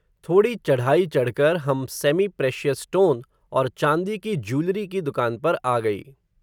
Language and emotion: Hindi, neutral